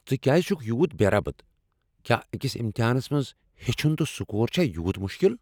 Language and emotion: Kashmiri, angry